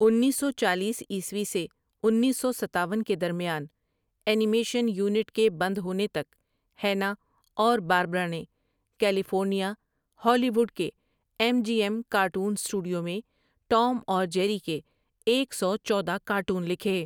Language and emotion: Urdu, neutral